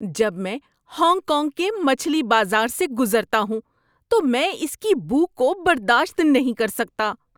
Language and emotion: Urdu, disgusted